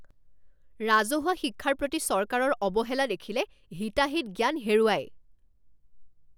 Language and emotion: Assamese, angry